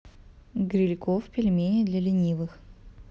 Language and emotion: Russian, neutral